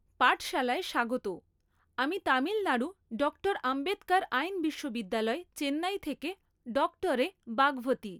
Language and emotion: Bengali, neutral